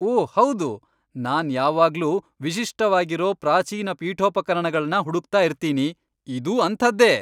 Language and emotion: Kannada, happy